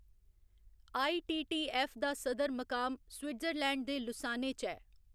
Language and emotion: Dogri, neutral